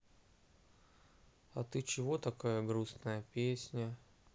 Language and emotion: Russian, sad